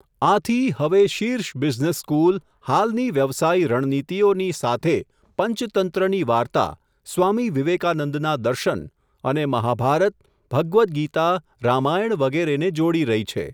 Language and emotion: Gujarati, neutral